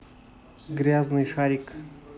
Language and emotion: Russian, neutral